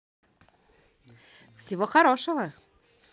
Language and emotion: Russian, positive